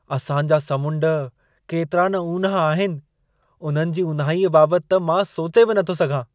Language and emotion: Sindhi, surprised